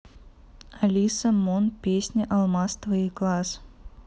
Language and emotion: Russian, neutral